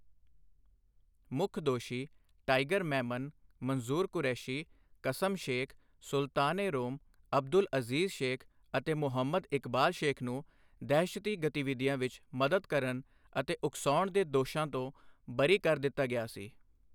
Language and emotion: Punjabi, neutral